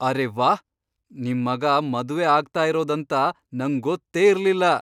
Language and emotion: Kannada, surprised